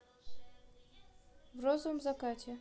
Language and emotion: Russian, neutral